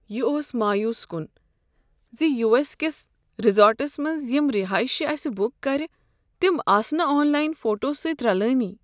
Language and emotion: Kashmiri, sad